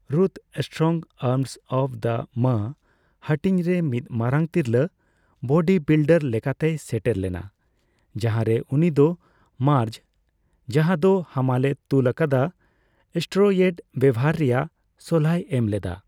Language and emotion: Santali, neutral